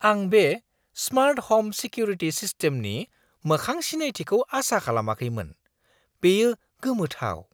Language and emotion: Bodo, surprised